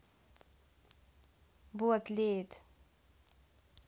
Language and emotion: Russian, neutral